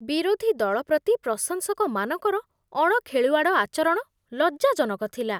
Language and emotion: Odia, disgusted